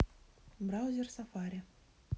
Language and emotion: Russian, neutral